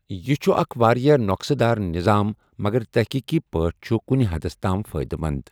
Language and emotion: Kashmiri, neutral